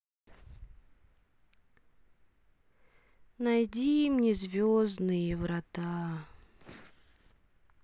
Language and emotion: Russian, sad